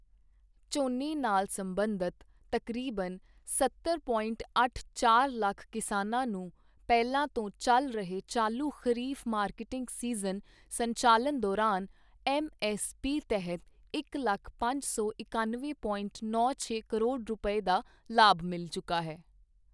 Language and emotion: Punjabi, neutral